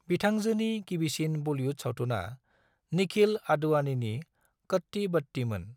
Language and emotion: Bodo, neutral